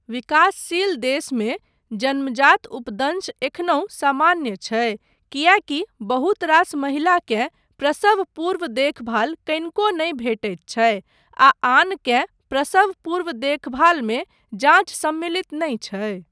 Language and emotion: Maithili, neutral